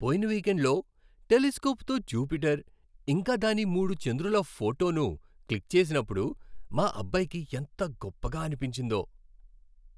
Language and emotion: Telugu, happy